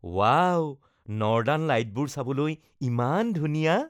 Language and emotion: Assamese, happy